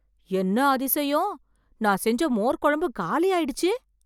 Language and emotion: Tamil, surprised